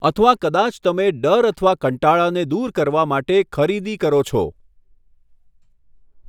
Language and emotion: Gujarati, neutral